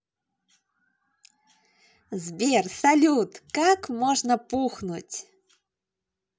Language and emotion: Russian, positive